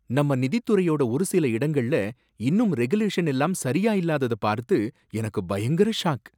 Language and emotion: Tamil, surprised